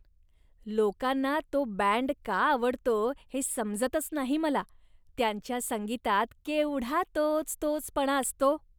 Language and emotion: Marathi, disgusted